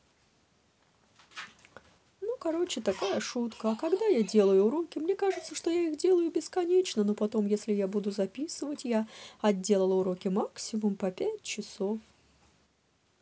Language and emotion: Russian, neutral